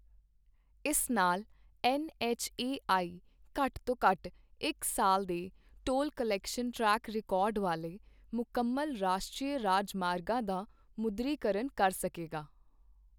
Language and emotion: Punjabi, neutral